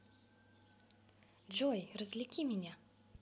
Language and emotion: Russian, positive